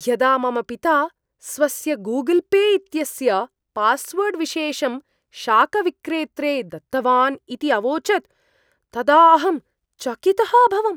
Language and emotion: Sanskrit, surprised